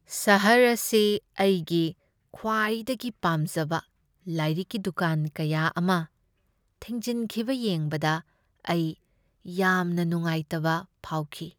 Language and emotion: Manipuri, sad